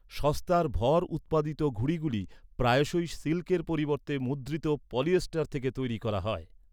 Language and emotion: Bengali, neutral